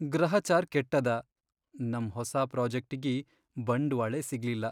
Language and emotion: Kannada, sad